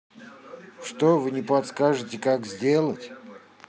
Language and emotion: Russian, neutral